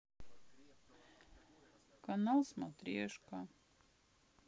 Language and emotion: Russian, sad